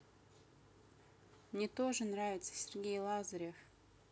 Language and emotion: Russian, neutral